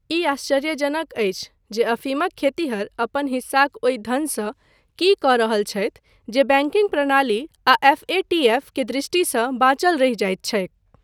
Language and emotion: Maithili, neutral